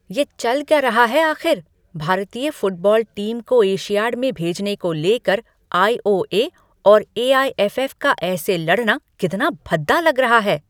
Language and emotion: Hindi, angry